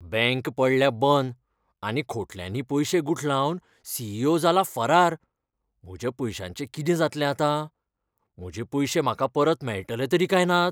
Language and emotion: Goan Konkani, fearful